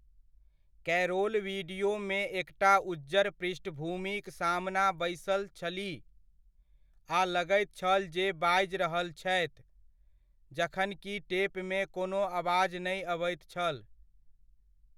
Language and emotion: Maithili, neutral